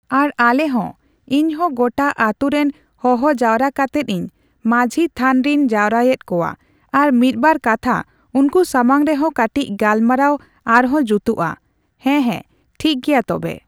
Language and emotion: Santali, neutral